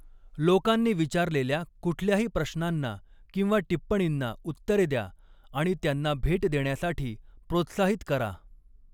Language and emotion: Marathi, neutral